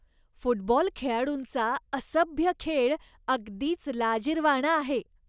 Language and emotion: Marathi, disgusted